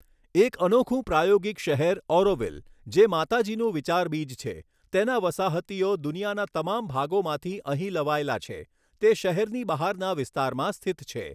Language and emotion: Gujarati, neutral